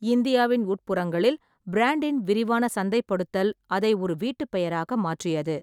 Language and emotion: Tamil, neutral